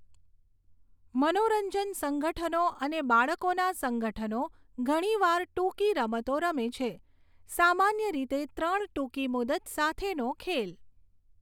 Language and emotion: Gujarati, neutral